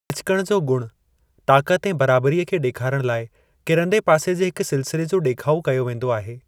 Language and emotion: Sindhi, neutral